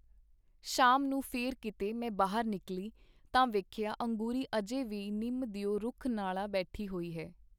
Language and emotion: Punjabi, neutral